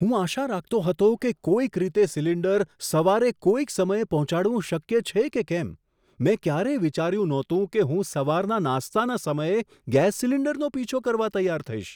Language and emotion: Gujarati, surprised